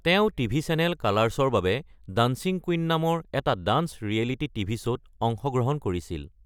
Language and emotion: Assamese, neutral